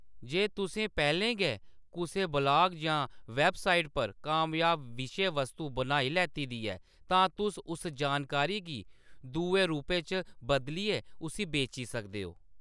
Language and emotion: Dogri, neutral